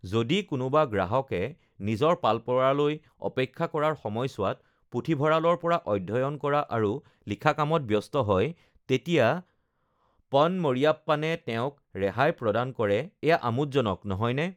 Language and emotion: Assamese, neutral